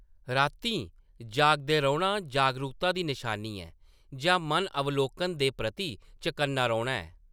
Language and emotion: Dogri, neutral